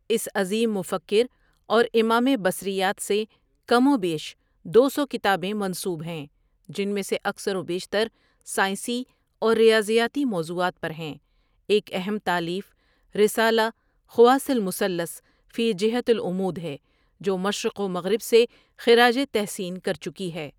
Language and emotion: Urdu, neutral